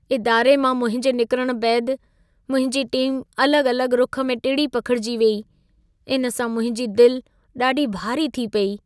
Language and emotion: Sindhi, sad